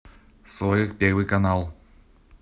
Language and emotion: Russian, neutral